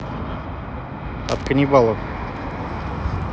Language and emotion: Russian, neutral